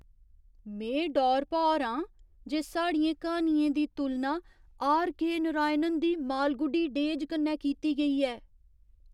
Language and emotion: Dogri, surprised